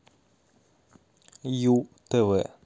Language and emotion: Russian, neutral